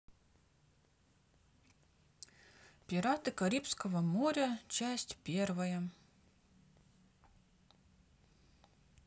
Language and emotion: Russian, neutral